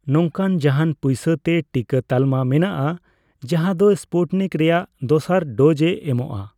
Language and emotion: Santali, neutral